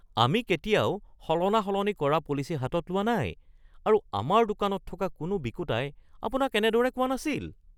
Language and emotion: Assamese, surprised